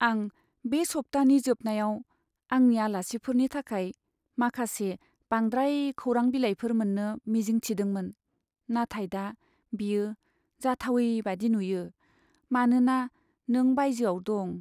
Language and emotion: Bodo, sad